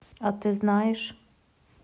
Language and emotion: Russian, neutral